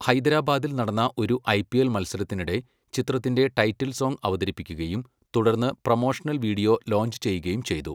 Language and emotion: Malayalam, neutral